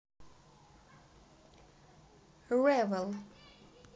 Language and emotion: Russian, positive